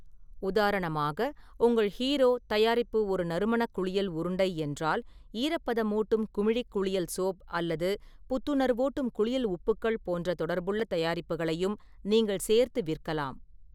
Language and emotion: Tamil, neutral